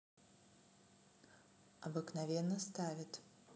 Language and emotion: Russian, neutral